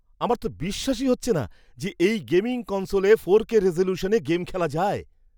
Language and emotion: Bengali, surprised